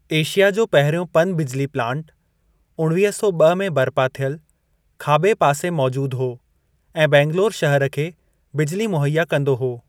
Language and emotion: Sindhi, neutral